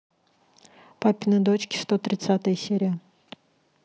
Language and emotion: Russian, neutral